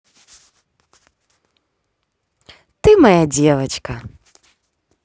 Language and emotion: Russian, positive